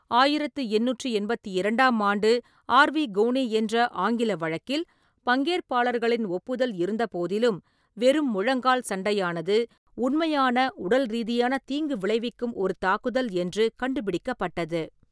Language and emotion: Tamil, neutral